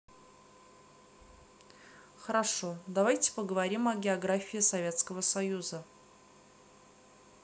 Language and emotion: Russian, neutral